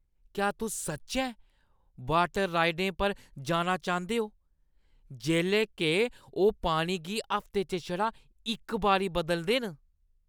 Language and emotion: Dogri, disgusted